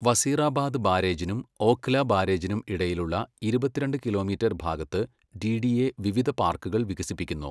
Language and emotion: Malayalam, neutral